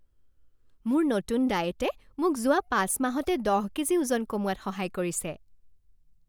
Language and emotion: Assamese, happy